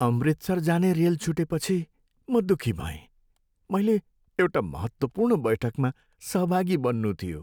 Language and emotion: Nepali, sad